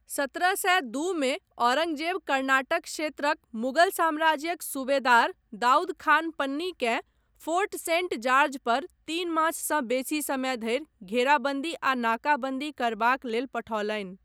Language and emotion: Maithili, neutral